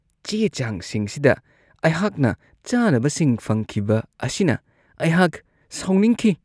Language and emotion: Manipuri, disgusted